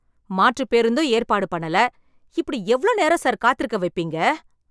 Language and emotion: Tamil, angry